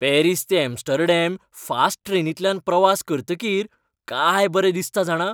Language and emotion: Goan Konkani, happy